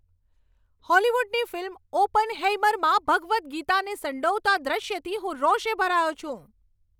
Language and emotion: Gujarati, angry